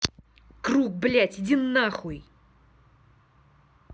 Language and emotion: Russian, angry